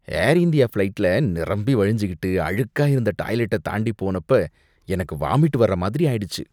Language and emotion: Tamil, disgusted